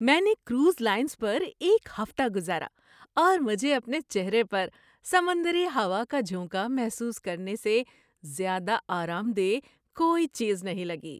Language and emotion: Urdu, happy